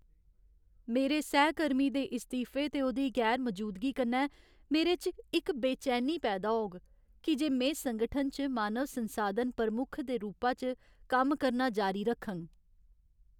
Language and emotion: Dogri, sad